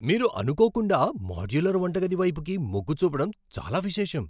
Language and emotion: Telugu, surprised